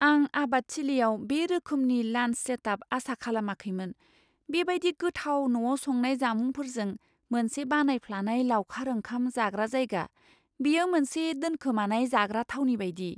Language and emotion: Bodo, surprised